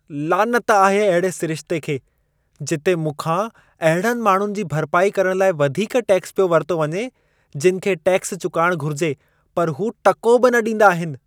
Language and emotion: Sindhi, disgusted